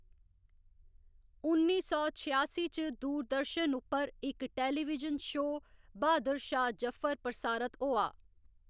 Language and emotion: Dogri, neutral